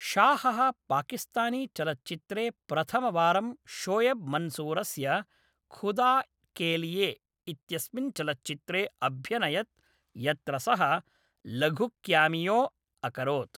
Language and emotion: Sanskrit, neutral